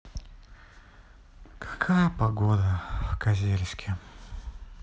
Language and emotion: Russian, sad